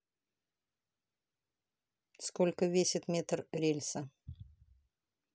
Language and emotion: Russian, neutral